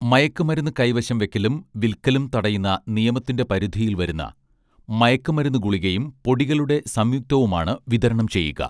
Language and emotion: Malayalam, neutral